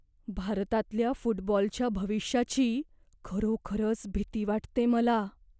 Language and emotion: Marathi, fearful